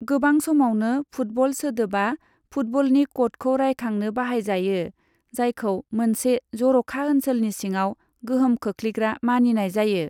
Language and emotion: Bodo, neutral